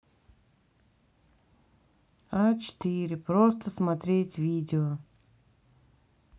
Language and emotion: Russian, angry